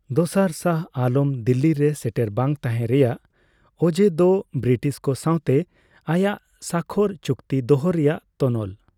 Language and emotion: Santali, neutral